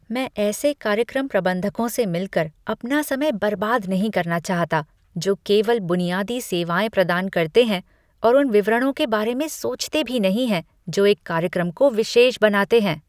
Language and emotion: Hindi, disgusted